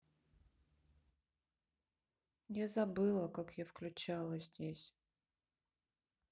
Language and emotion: Russian, sad